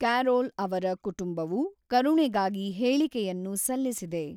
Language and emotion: Kannada, neutral